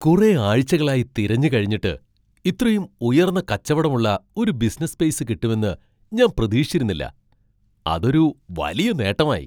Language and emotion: Malayalam, surprised